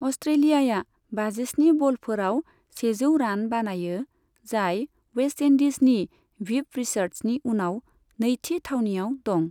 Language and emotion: Bodo, neutral